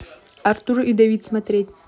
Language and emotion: Russian, neutral